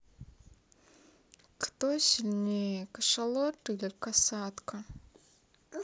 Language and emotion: Russian, sad